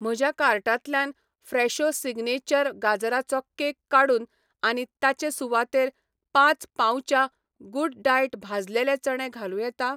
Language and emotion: Goan Konkani, neutral